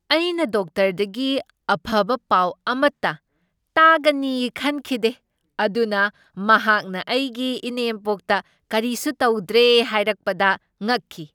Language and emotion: Manipuri, surprised